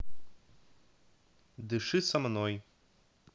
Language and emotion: Russian, neutral